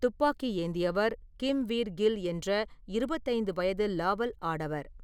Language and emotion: Tamil, neutral